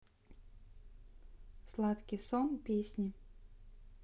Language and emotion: Russian, neutral